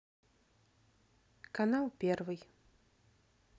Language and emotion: Russian, neutral